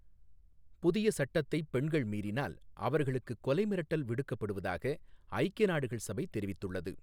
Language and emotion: Tamil, neutral